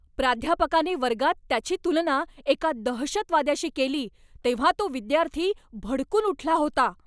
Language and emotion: Marathi, angry